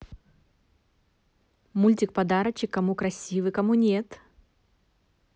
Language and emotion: Russian, positive